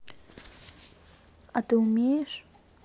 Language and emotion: Russian, neutral